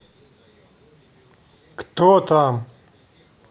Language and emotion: Russian, angry